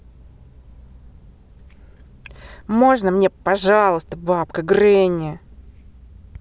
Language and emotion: Russian, angry